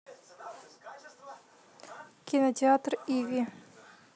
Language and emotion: Russian, neutral